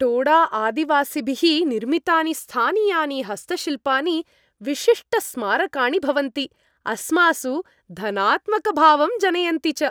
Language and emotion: Sanskrit, happy